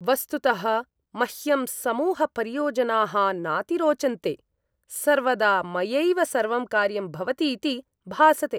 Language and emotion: Sanskrit, disgusted